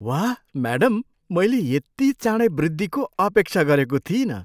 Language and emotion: Nepali, surprised